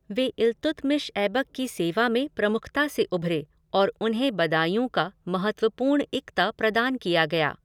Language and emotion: Hindi, neutral